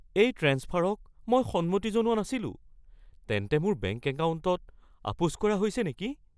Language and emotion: Assamese, fearful